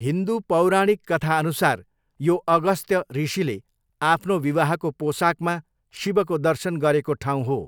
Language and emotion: Nepali, neutral